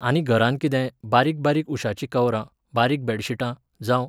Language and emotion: Goan Konkani, neutral